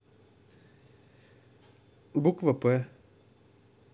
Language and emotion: Russian, neutral